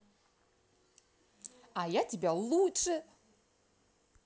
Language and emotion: Russian, positive